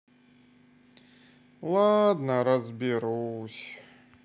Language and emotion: Russian, sad